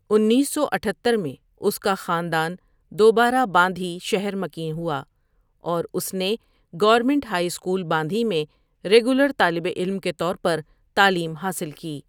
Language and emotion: Urdu, neutral